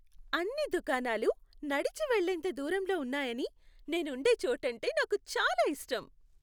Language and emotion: Telugu, happy